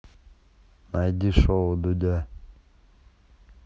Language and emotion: Russian, neutral